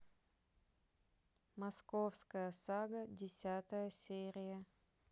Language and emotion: Russian, neutral